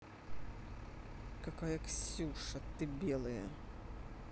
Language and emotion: Russian, angry